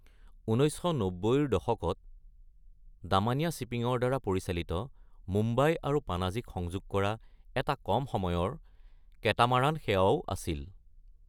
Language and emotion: Assamese, neutral